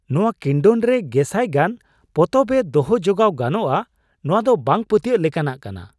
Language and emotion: Santali, surprised